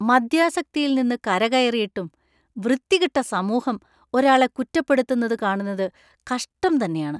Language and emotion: Malayalam, disgusted